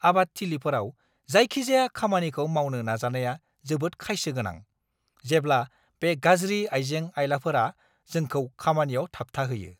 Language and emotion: Bodo, angry